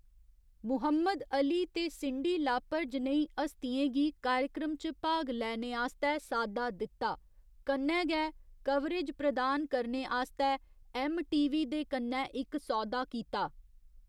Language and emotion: Dogri, neutral